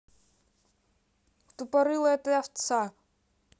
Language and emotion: Russian, neutral